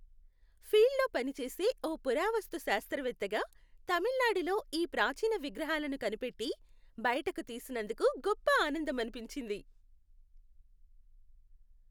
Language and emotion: Telugu, happy